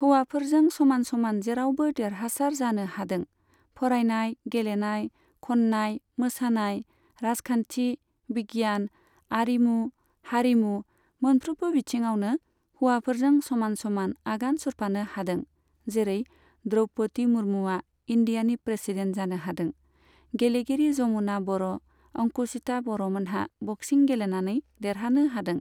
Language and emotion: Bodo, neutral